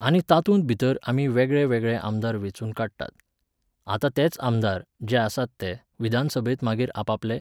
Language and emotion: Goan Konkani, neutral